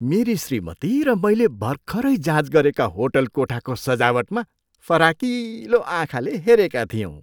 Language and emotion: Nepali, surprised